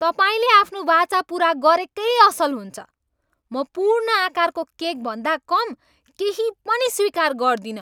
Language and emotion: Nepali, angry